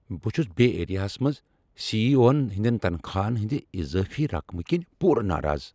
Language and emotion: Kashmiri, angry